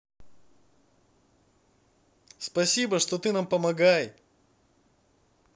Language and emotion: Russian, positive